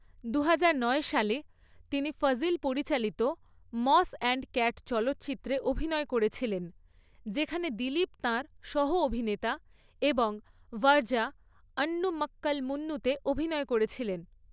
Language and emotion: Bengali, neutral